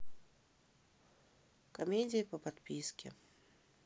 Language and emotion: Russian, sad